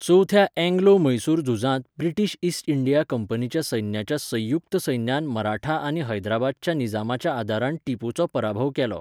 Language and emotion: Goan Konkani, neutral